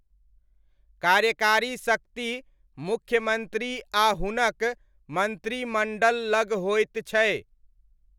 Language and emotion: Maithili, neutral